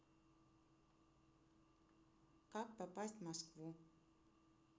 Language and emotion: Russian, neutral